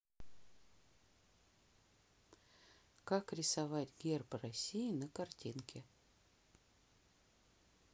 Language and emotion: Russian, neutral